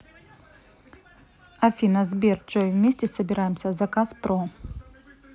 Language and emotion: Russian, neutral